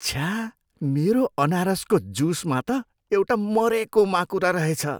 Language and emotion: Nepali, disgusted